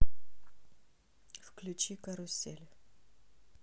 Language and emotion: Russian, neutral